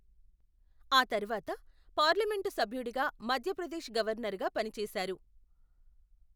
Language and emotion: Telugu, neutral